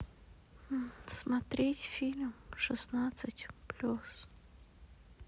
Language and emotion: Russian, sad